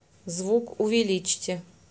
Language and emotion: Russian, neutral